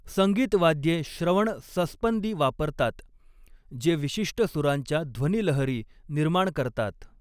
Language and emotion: Marathi, neutral